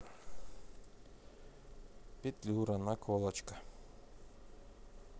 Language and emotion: Russian, neutral